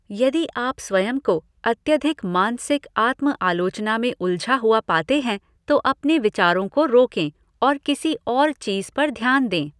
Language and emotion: Hindi, neutral